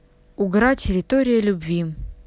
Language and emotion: Russian, neutral